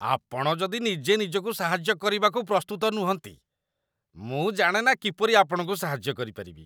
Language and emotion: Odia, disgusted